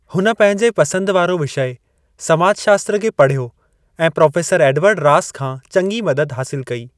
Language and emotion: Sindhi, neutral